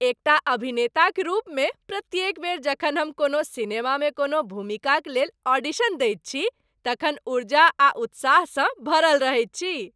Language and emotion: Maithili, happy